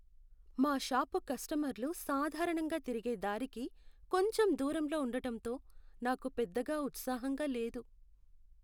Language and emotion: Telugu, sad